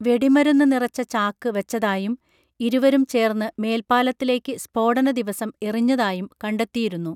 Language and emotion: Malayalam, neutral